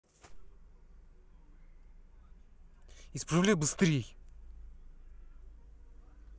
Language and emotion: Russian, angry